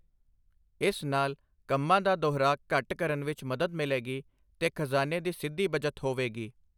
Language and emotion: Punjabi, neutral